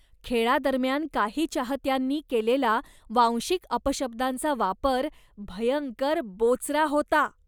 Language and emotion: Marathi, disgusted